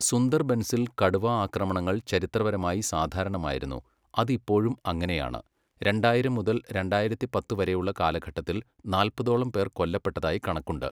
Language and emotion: Malayalam, neutral